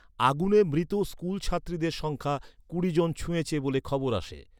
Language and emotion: Bengali, neutral